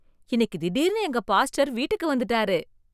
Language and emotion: Tamil, surprised